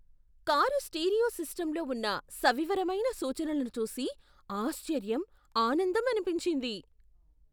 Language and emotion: Telugu, surprised